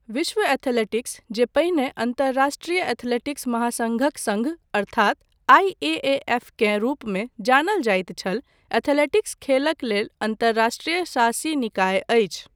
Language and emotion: Maithili, neutral